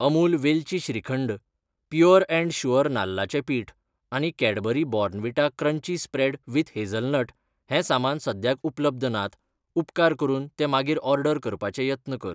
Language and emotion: Goan Konkani, neutral